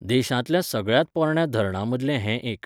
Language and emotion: Goan Konkani, neutral